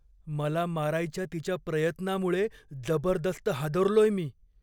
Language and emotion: Marathi, fearful